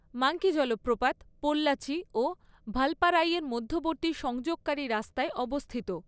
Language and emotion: Bengali, neutral